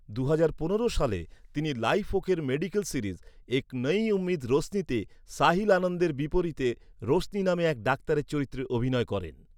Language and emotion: Bengali, neutral